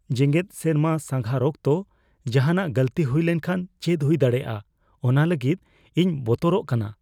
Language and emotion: Santali, fearful